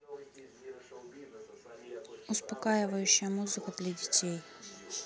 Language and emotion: Russian, neutral